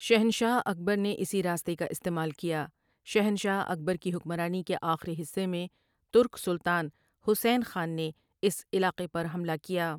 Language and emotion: Urdu, neutral